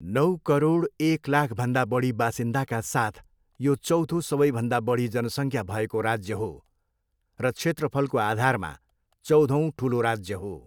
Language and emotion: Nepali, neutral